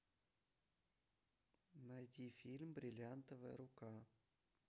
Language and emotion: Russian, neutral